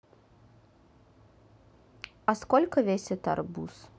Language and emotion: Russian, neutral